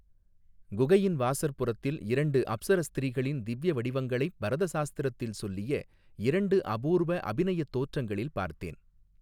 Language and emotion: Tamil, neutral